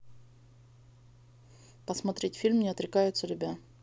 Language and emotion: Russian, neutral